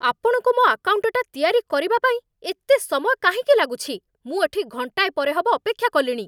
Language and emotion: Odia, angry